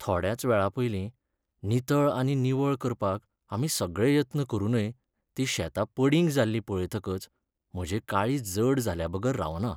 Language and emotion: Goan Konkani, sad